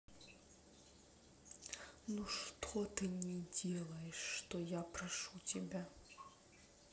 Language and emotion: Russian, sad